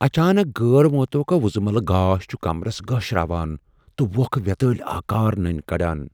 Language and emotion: Kashmiri, fearful